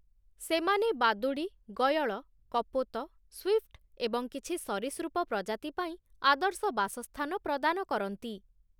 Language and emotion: Odia, neutral